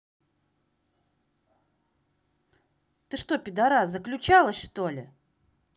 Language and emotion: Russian, angry